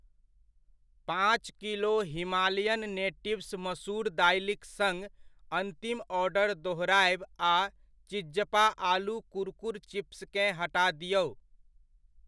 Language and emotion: Maithili, neutral